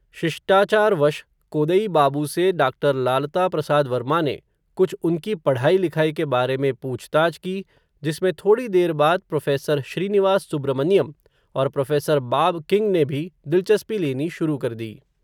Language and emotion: Hindi, neutral